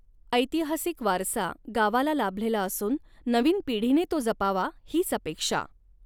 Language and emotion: Marathi, neutral